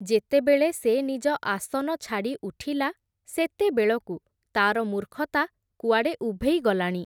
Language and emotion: Odia, neutral